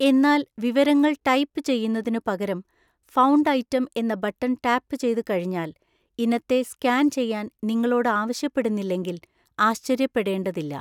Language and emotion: Malayalam, neutral